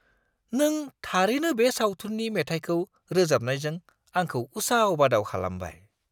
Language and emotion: Bodo, surprised